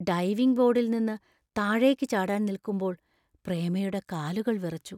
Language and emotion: Malayalam, fearful